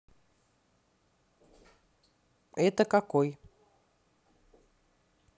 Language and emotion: Russian, neutral